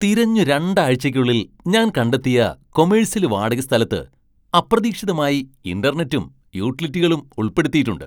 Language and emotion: Malayalam, surprised